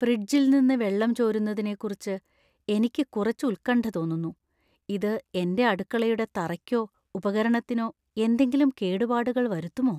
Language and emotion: Malayalam, fearful